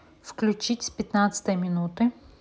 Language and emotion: Russian, neutral